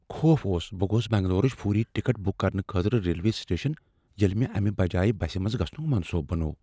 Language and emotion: Kashmiri, fearful